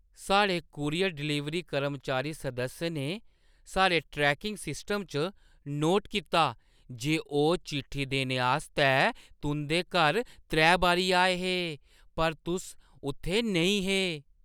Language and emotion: Dogri, surprised